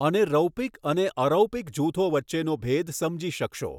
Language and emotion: Gujarati, neutral